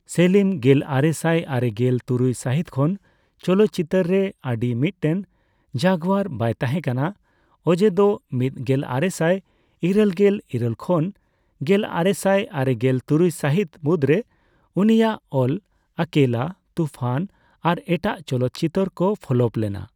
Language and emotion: Santali, neutral